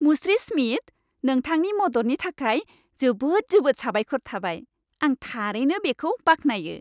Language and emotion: Bodo, happy